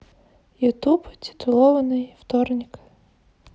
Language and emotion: Russian, neutral